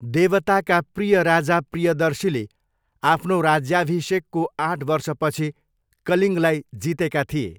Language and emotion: Nepali, neutral